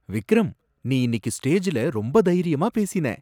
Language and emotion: Tamil, surprised